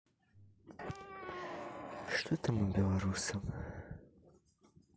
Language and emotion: Russian, sad